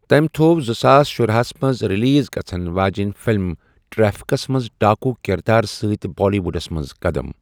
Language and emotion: Kashmiri, neutral